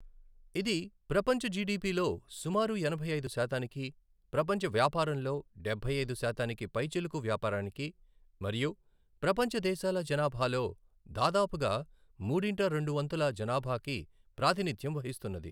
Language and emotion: Telugu, neutral